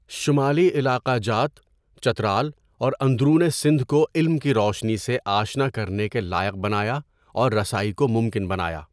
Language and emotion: Urdu, neutral